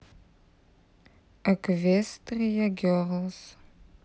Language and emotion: Russian, neutral